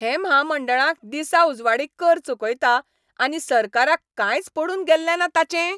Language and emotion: Goan Konkani, angry